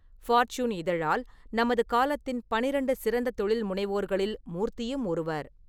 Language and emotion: Tamil, neutral